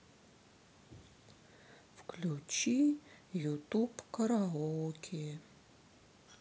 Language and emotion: Russian, sad